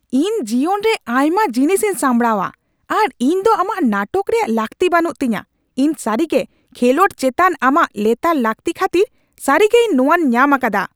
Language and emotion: Santali, angry